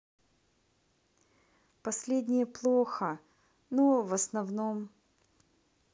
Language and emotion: Russian, sad